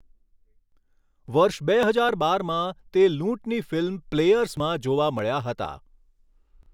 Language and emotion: Gujarati, neutral